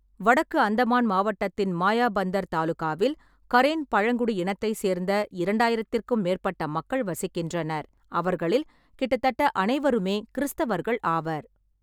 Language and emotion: Tamil, neutral